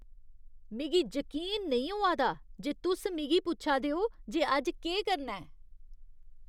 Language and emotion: Dogri, disgusted